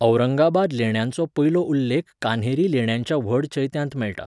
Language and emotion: Goan Konkani, neutral